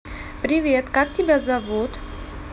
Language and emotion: Russian, neutral